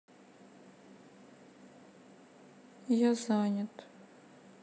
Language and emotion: Russian, sad